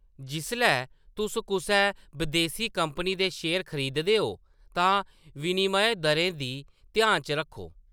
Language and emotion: Dogri, neutral